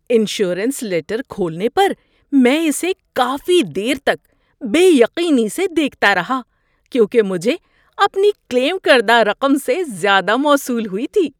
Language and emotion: Urdu, surprised